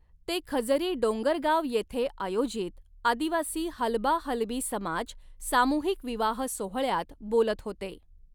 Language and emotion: Marathi, neutral